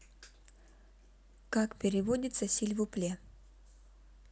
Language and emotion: Russian, neutral